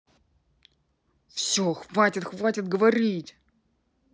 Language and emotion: Russian, angry